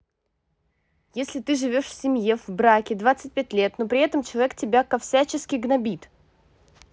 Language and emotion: Russian, angry